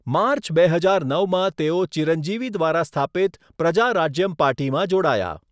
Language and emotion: Gujarati, neutral